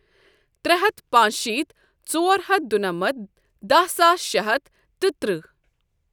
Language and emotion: Kashmiri, neutral